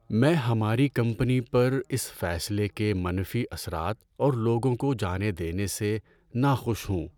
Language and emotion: Urdu, sad